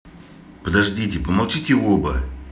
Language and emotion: Russian, angry